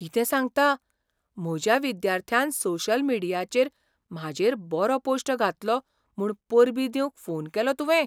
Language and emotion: Goan Konkani, surprised